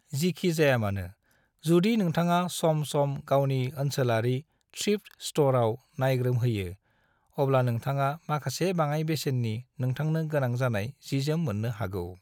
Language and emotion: Bodo, neutral